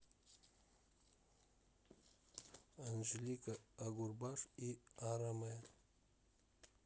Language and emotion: Russian, neutral